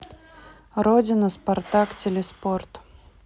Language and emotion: Russian, neutral